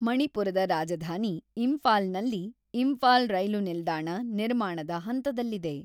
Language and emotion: Kannada, neutral